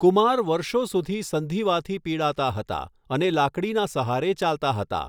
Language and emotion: Gujarati, neutral